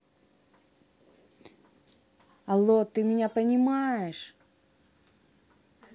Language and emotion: Russian, angry